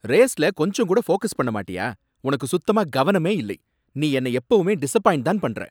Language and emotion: Tamil, angry